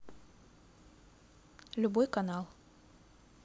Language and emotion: Russian, neutral